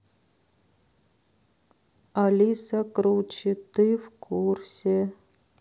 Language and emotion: Russian, sad